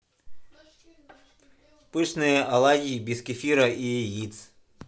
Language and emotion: Russian, positive